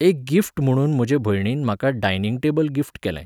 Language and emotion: Goan Konkani, neutral